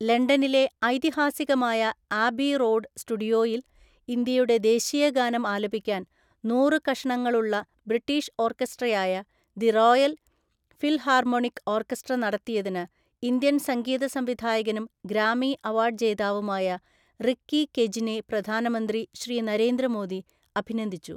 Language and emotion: Malayalam, neutral